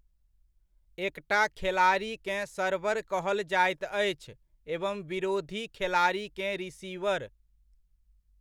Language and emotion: Maithili, neutral